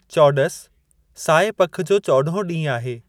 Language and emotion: Sindhi, neutral